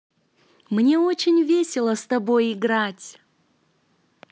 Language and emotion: Russian, positive